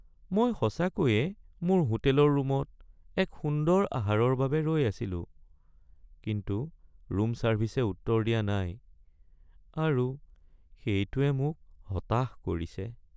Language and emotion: Assamese, sad